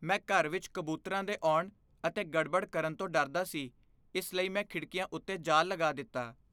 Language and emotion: Punjabi, fearful